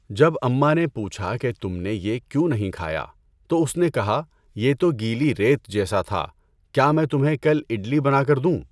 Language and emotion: Urdu, neutral